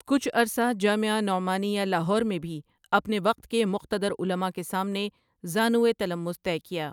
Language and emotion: Urdu, neutral